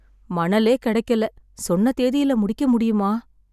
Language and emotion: Tamil, sad